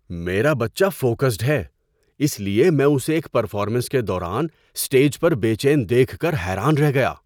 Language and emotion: Urdu, surprised